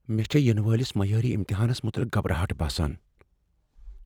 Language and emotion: Kashmiri, fearful